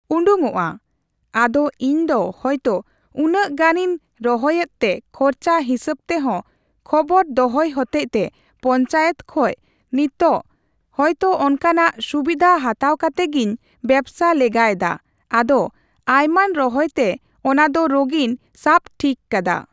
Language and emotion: Santali, neutral